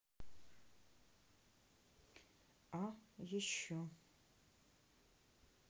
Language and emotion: Russian, neutral